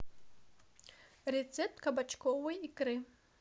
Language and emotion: Russian, neutral